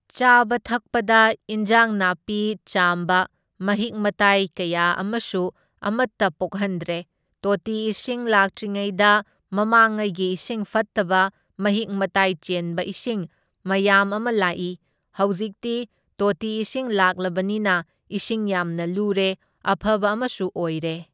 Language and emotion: Manipuri, neutral